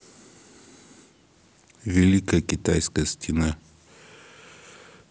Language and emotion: Russian, neutral